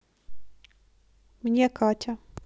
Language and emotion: Russian, neutral